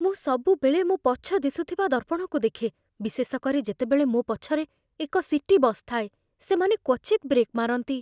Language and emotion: Odia, fearful